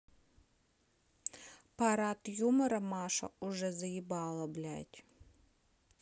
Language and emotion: Russian, neutral